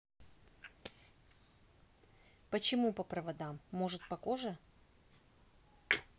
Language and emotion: Russian, neutral